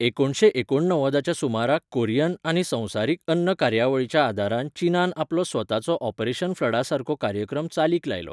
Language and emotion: Goan Konkani, neutral